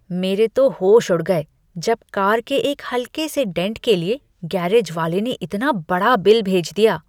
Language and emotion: Hindi, disgusted